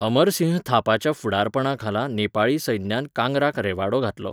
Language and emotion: Goan Konkani, neutral